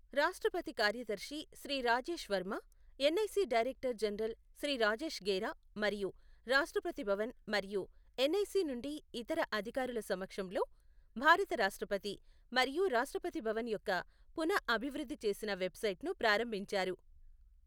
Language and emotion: Telugu, neutral